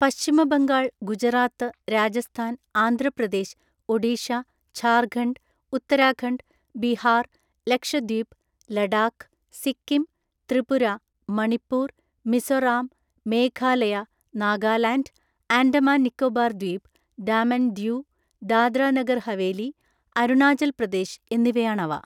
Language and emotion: Malayalam, neutral